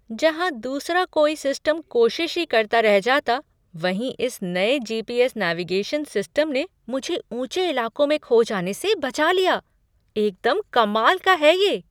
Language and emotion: Hindi, surprised